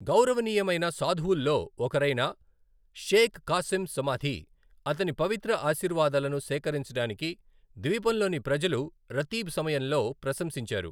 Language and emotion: Telugu, neutral